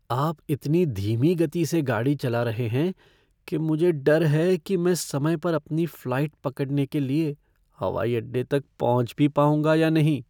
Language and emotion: Hindi, fearful